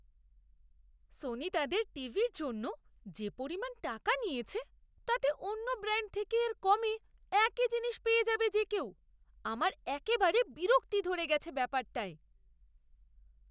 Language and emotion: Bengali, disgusted